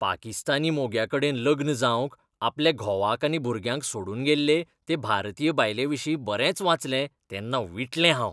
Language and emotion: Goan Konkani, disgusted